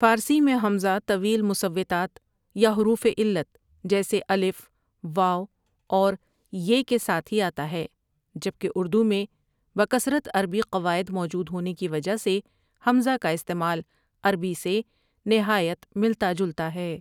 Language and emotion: Urdu, neutral